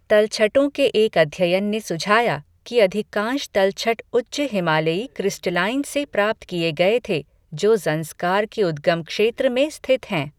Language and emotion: Hindi, neutral